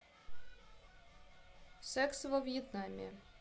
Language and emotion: Russian, neutral